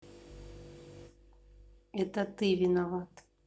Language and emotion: Russian, sad